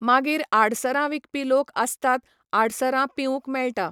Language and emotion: Goan Konkani, neutral